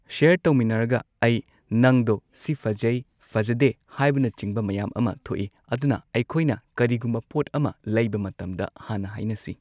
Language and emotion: Manipuri, neutral